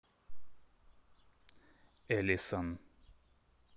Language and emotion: Russian, neutral